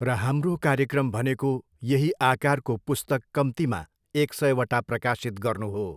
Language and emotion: Nepali, neutral